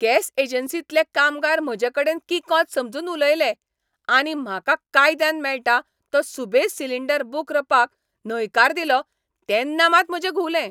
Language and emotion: Goan Konkani, angry